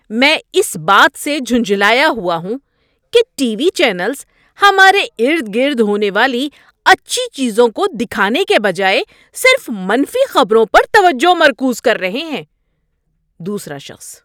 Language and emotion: Urdu, angry